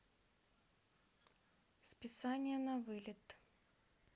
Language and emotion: Russian, neutral